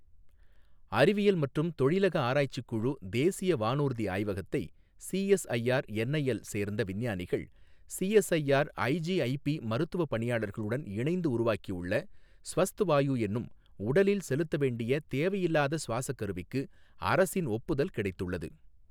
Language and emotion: Tamil, neutral